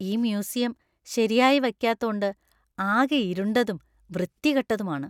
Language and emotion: Malayalam, disgusted